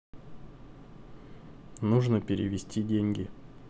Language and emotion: Russian, neutral